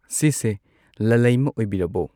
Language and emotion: Manipuri, neutral